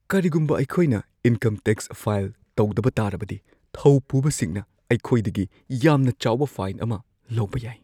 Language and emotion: Manipuri, fearful